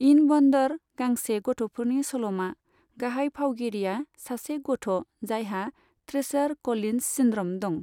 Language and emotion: Bodo, neutral